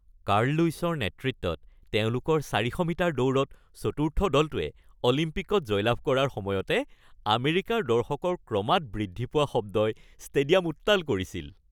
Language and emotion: Assamese, happy